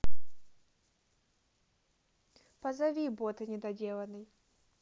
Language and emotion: Russian, neutral